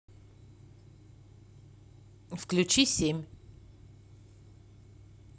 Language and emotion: Russian, neutral